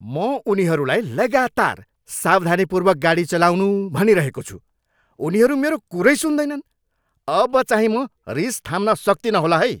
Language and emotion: Nepali, angry